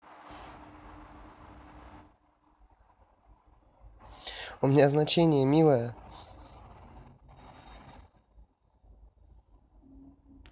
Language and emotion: Russian, positive